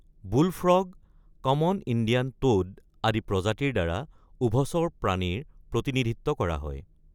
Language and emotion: Assamese, neutral